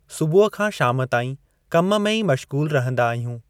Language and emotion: Sindhi, neutral